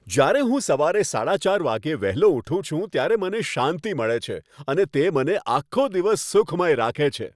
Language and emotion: Gujarati, happy